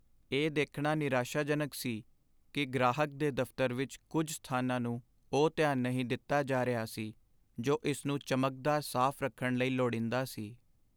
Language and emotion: Punjabi, sad